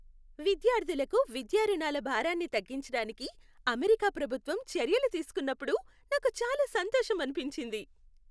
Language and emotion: Telugu, happy